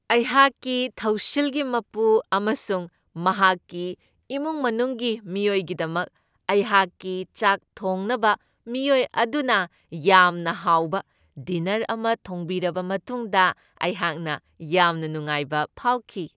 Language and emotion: Manipuri, happy